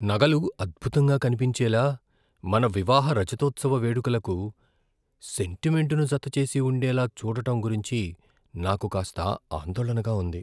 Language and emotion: Telugu, fearful